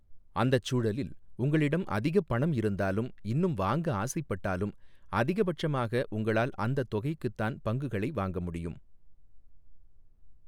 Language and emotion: Tamil, neutral